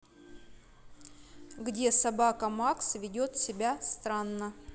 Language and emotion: Russian, neutral